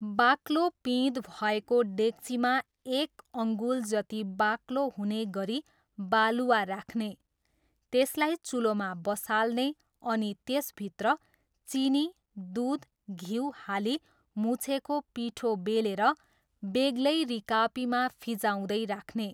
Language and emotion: Nepali, neutral